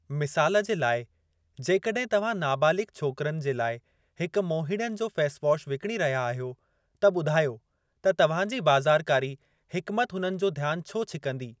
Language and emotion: Sindhi, neutral